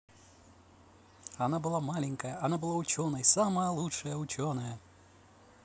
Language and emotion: Russian, positive